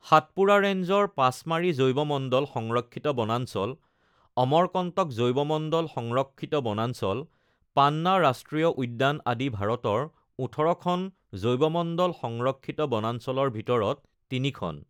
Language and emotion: Assamese, neutral